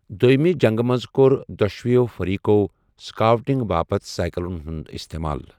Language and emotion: Kashmiri, neutral